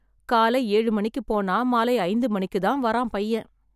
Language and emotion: Tamil, sad